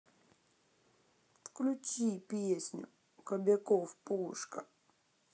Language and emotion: Russian, sad